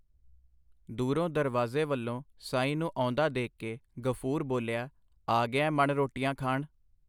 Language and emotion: Punjabi, neutral